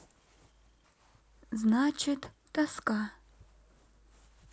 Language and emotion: Russian, sad